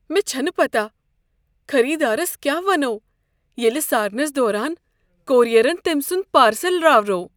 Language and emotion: Kashmiri, fearful